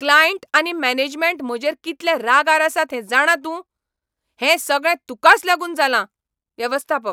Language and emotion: Goan Konkani, angry